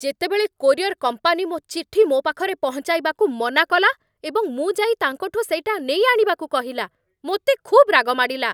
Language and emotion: Odia, angry